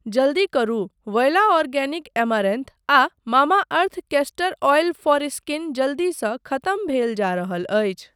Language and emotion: Maithili, neutral